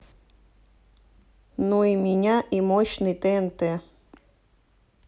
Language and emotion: Russian, neutral